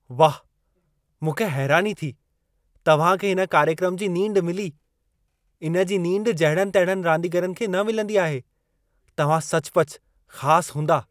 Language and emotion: Sindhi, surprised